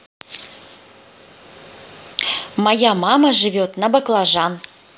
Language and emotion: Russian, neutral